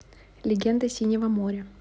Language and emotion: Russian, neutral